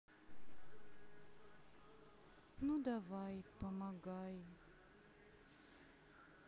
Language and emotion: Russian, sad